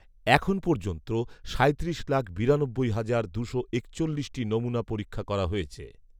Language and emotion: Bengali, neutral